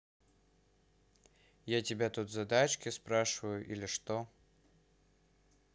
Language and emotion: Russian, neutral